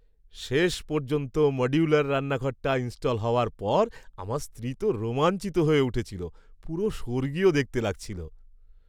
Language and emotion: Bengali, happy